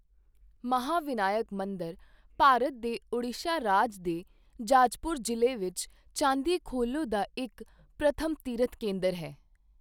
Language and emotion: Punjabi, neutral